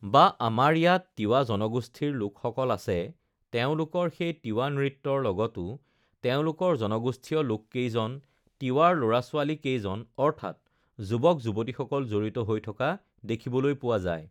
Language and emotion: Assamese, neutral